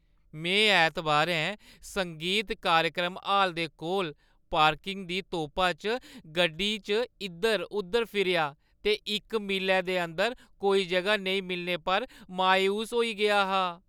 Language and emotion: Dogri, sad